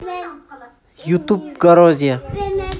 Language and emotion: Russian, neutral